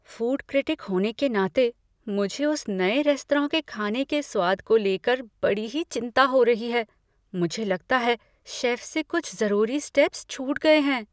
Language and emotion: Hindi, fearful